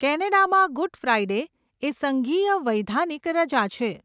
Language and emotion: Gujarati, neutral